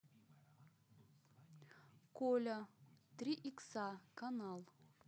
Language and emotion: Russian, neutral